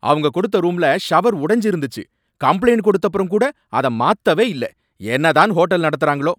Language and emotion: Tamil, angry